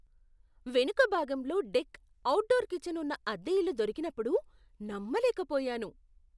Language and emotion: Telugu, surprised